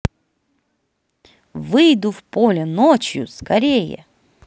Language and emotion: Russian, positive